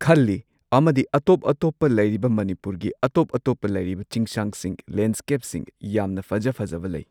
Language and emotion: Manipuri, neutral